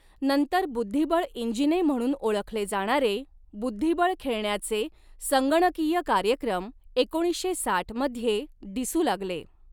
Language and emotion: Marathi, neutral